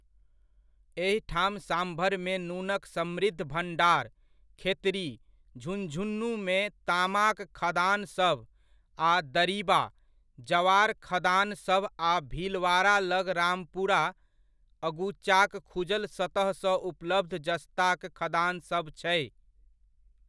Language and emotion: Maithili, neutral